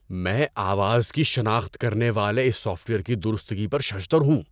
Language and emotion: Urdu, surprised